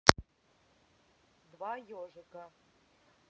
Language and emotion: Russian, angry